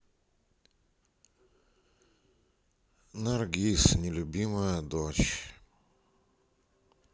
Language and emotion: Russian, sad